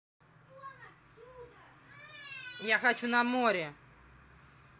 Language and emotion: Russian, angry